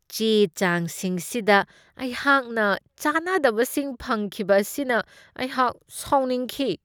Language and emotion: Manipuri, disgusted